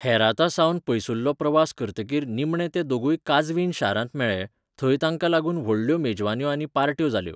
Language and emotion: Goan Konkani, neutral